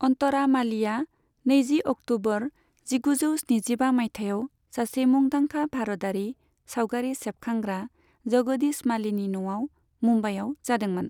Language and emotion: Bodo, neutral